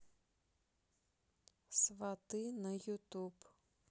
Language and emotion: Russian, neutral